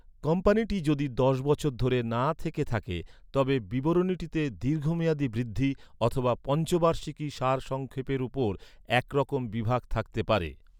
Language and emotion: Bengali, neutral